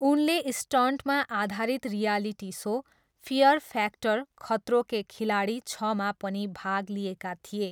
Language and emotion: Nepali, neutral